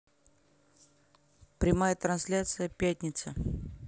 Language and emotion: Russian, neutral